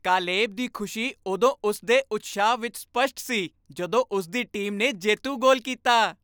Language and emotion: Punjabi, happy